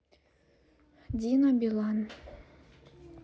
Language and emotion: Russian, neutral